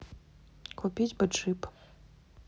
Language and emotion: Russian, neutral